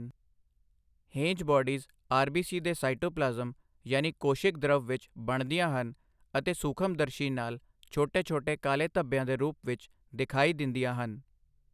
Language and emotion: Punjabi, neutral